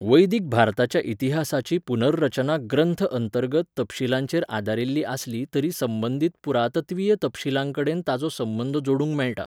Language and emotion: Goan Konkani, neutral